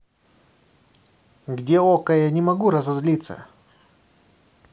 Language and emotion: Russian, angry